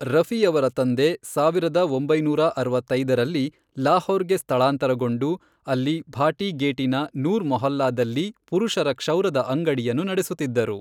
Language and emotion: Kannada, neutral